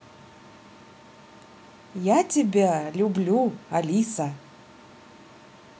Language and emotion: Russian, positive